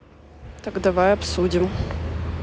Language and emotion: Russian, neutral